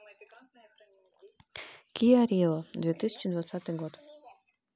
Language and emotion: Russian, neutral